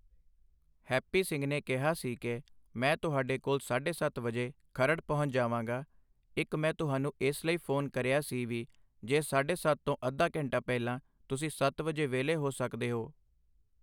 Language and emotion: Punjabi, neutral